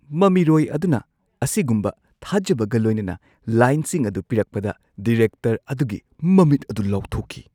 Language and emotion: Manipuri, surprised